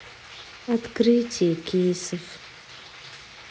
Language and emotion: Russian, sad